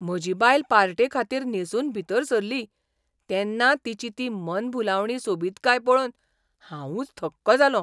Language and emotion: Goan Konkani, surprised